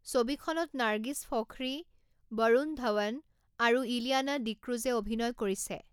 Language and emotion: Assamese, neutral